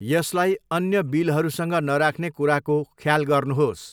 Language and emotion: Nepali, neutral